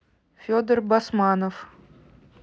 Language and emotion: Russian, neutral